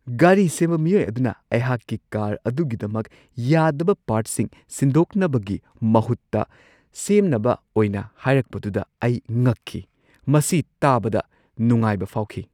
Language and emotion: Manipuri, surprised